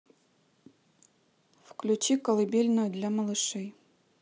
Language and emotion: Russian, neutral